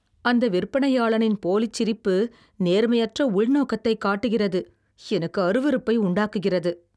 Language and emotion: Tamil, disgusted